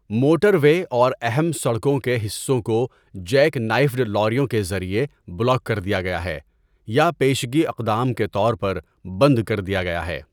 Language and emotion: Urdu, neutral